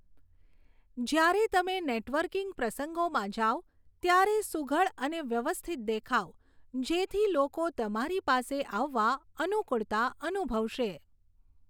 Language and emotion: Gujarati, neutral